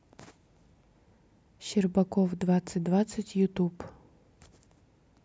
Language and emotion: Russian, neutral